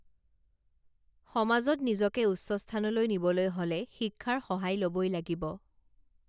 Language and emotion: Assamese, neutral